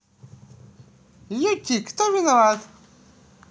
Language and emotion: Russian, positive